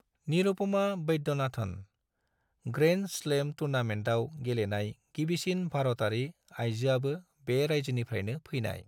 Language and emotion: Bodo, neutral